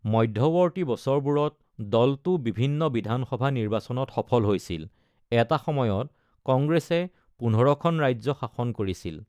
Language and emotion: Assamese, neutral